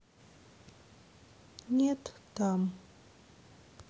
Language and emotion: Russian, sad